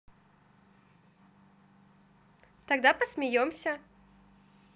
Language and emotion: Russian, positive